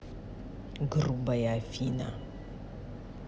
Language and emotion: Russian, angry